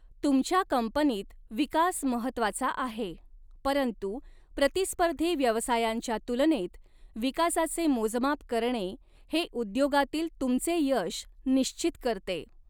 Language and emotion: Marathi, neutral